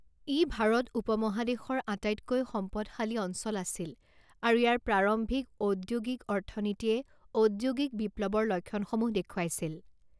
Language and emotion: Assamese, neutral